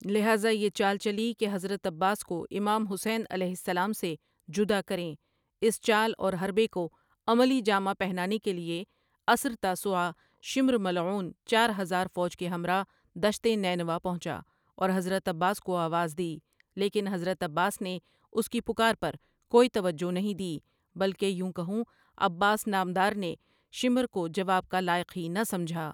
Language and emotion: Urdu, neutral